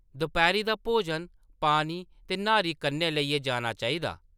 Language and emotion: Dogri, neutral